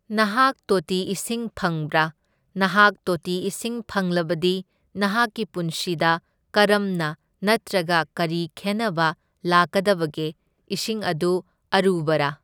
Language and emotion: Manipuri, neutral